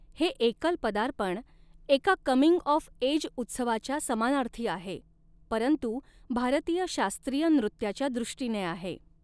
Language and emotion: Marathi, neutral